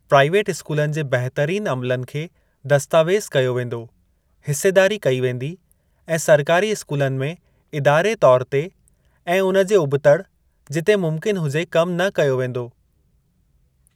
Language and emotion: Sindhi, neutral